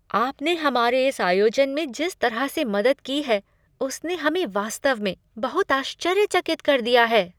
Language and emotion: Hindi, surprised